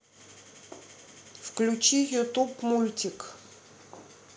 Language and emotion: Russian, neutral